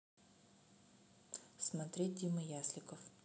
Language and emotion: Russian, neutral